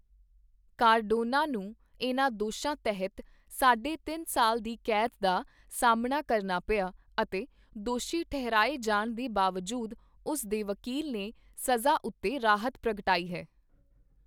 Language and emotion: Punjabi, neutral